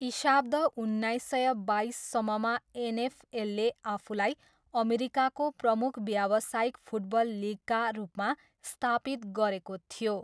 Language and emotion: Nepali, neutral